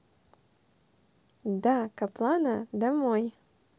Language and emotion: Russian, positive